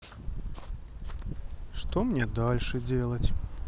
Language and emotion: Russian, sad